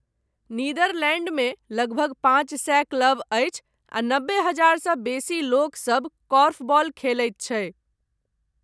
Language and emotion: Maithili, neutral